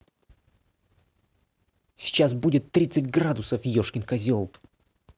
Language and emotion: Russian, angry